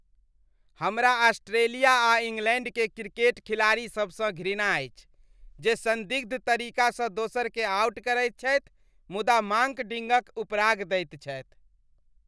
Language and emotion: Maithili, disgusted